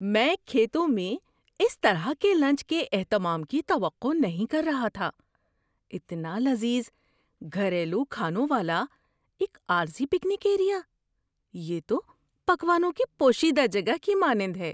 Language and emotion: Urdu, surprised